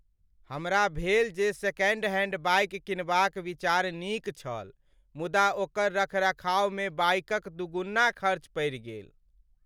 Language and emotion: Maithili, sad